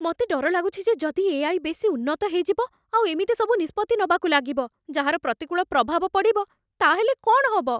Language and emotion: Odia, fearful